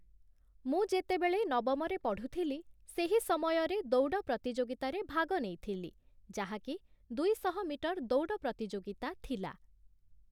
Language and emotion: Odia, neutral